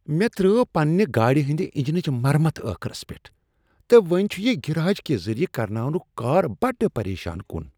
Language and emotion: Kashmiri, disgusted